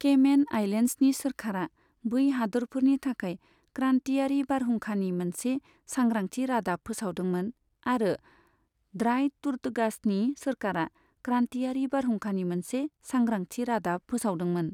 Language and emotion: Bodo, neutral